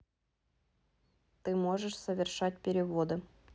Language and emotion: Russian, neutral